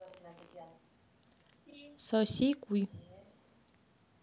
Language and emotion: Russian, neutral